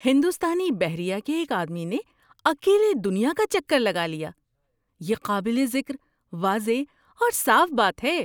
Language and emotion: Urdu, surprised